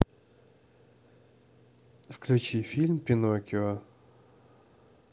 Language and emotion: Russian, neutral